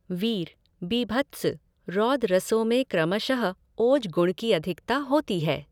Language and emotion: Hindi, neutral